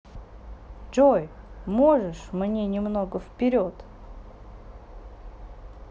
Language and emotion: Russian, neutral